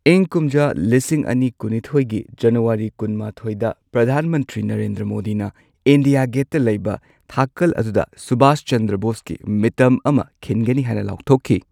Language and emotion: Manipuri, neutral